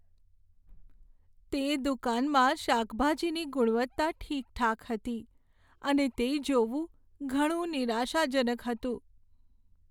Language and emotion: Gujarati, sad